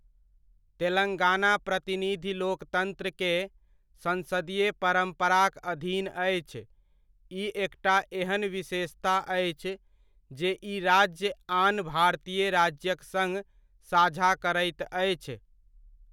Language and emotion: Maithili, neutral